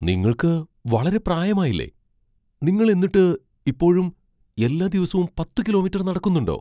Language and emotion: Malayalam, surprised